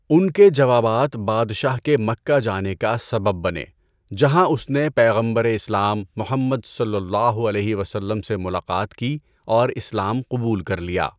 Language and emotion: Urdu, neutral